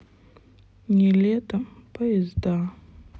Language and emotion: Russian, sad